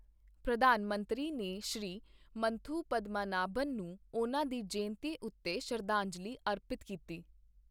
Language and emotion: Punjabi, neutral